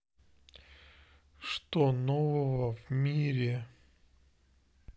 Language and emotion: Russian, neutral